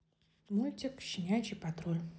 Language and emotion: Russian, neutral